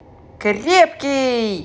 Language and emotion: Russian, positive